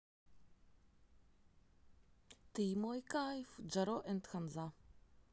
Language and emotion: Russian, positive